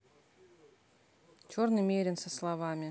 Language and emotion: Russian, neutral